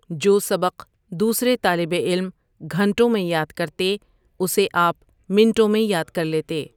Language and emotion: Urdu, neutral